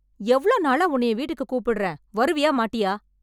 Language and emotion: Tamil, angry